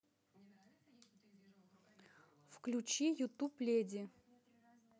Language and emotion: Russian, neutral